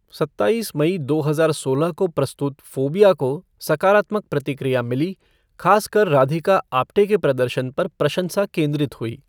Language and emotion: Hindi, neutral